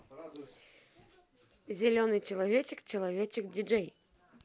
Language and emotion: Russian, positive